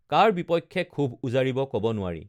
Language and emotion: Assamese, neutral